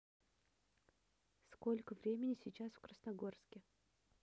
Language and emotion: Russian, neutral